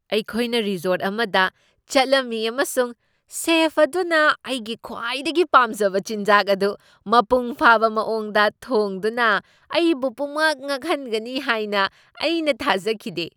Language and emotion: Manipuri, surprised